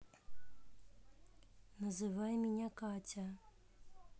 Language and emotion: Russian, neutral